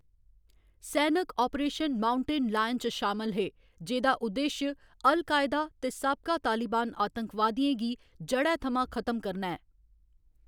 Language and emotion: Dogri, neutral